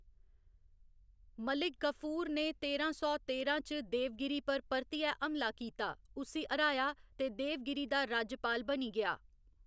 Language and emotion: Dogri, neutral